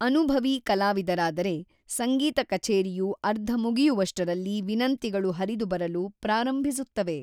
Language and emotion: Kannada, neutral